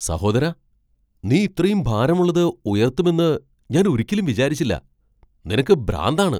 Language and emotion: Malayalam, surprised